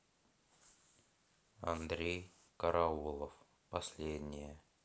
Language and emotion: Russian, sad